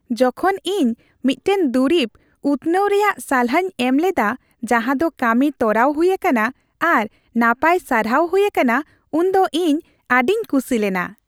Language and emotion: Santali, happy